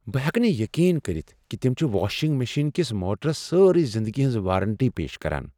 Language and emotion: Kashmiri, surprised